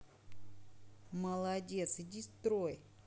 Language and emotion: Russian, positive